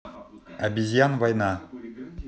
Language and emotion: Russian, neutral